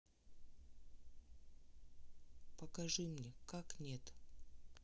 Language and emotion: Russian, neutral